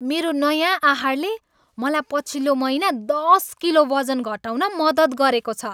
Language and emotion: Nepali, happy